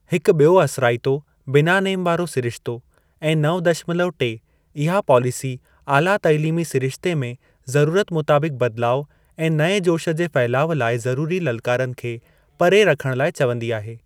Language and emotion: Sindhi, neutral